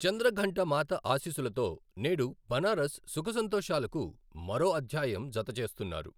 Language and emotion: Telugu, neutral